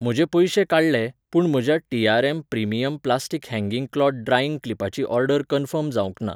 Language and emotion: Goan Konkani, neutral